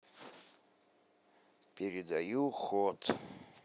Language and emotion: Russian, neutral